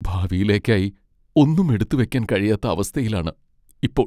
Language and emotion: Malayalam, sad